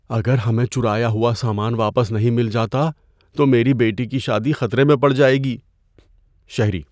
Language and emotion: Urdu, fearful